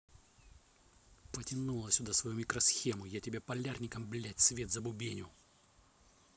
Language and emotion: Russian, angry